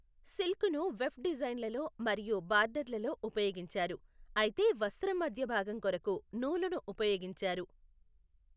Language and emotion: Telugu, neutral